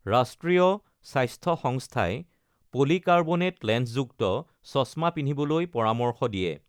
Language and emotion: Assamese, neutral